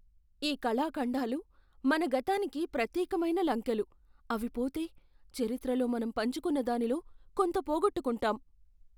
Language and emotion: Telugu, fearful